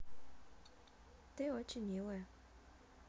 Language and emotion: Russian, positive